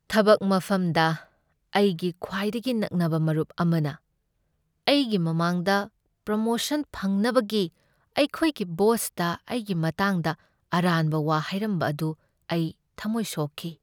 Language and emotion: Manipuri, sad